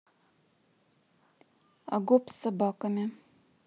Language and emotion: Russian, neutral